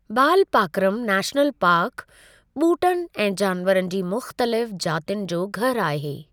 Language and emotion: Sindhi, neutral